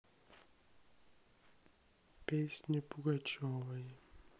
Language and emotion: Russian, sad